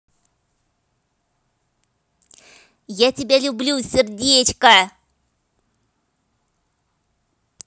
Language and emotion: Russian, positive